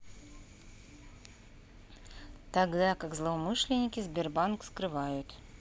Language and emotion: Russian, neutral